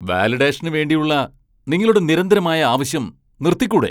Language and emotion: Malayalam, angry